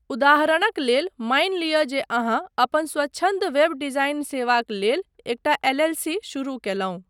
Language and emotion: Maithili, neutral